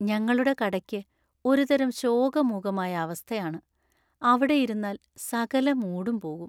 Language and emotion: Malayalam, sad